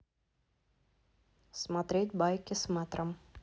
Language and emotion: Russian, neutral